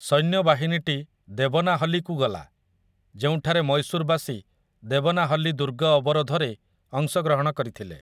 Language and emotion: Odia, neutral